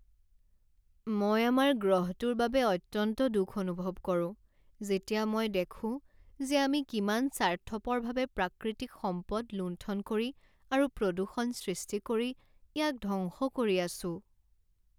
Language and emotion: Assamese, sad